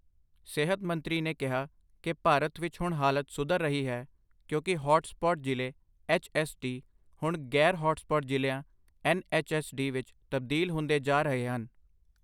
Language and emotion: Punjabi, neutral